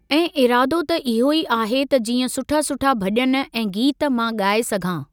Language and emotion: Sindhi, neutral